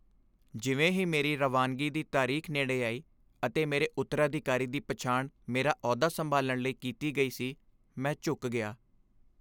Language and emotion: Punjabi, sad